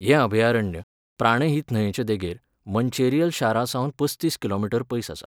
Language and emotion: Goan Konkani, neutral